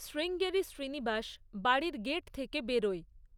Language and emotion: Bengali, neutral